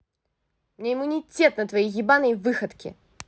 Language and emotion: Russian, angry